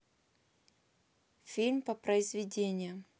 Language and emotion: Russian, neutral